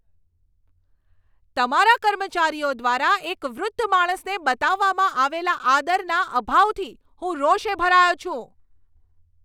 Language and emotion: Gujarati, angry